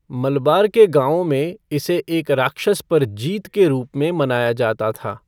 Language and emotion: Hindi, neutral